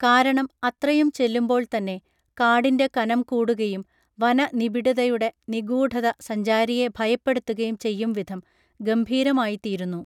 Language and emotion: Malayalam, neutral